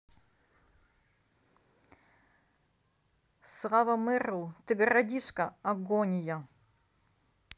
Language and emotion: Russian, neutral